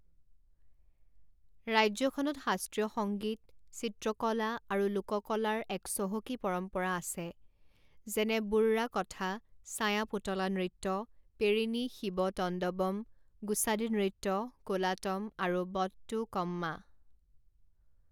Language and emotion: Assamese, neutral